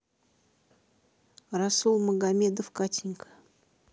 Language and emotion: Russian, neutral